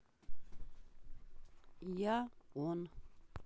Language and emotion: Russian, neutral